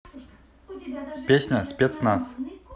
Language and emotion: Russian, neutral